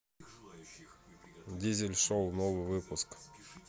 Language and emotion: Russian, neutral